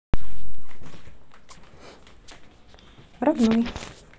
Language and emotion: Russian, neutral